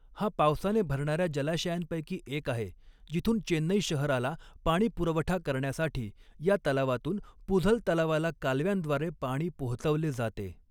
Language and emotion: Marathi, neutral